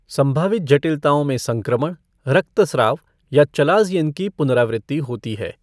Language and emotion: Hindi, neutral